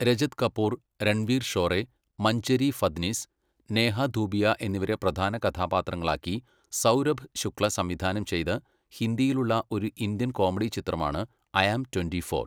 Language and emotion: Malayalam, neutral